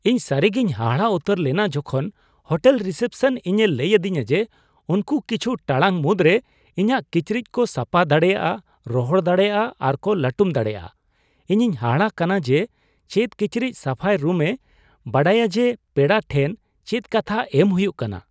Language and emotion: Santali, surprised